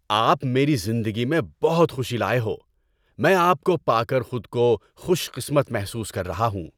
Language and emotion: Urdu, happy